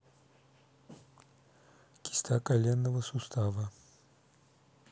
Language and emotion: Russian, neutral